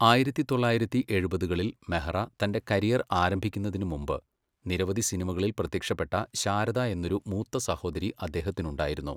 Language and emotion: Malayalam, neutral